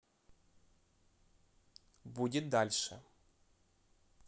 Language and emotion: Russian, neutral